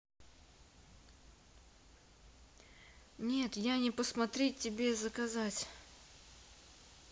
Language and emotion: Russian, neutral